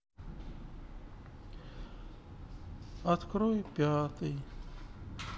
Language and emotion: Russian, sad